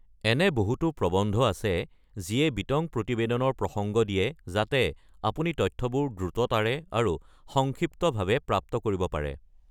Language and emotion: Assamese, neutral